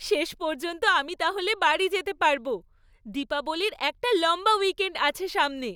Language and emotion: Bengali, happy